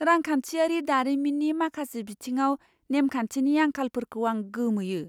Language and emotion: Bodo, surprised